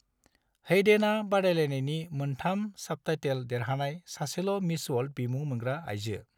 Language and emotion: Bodo, neutral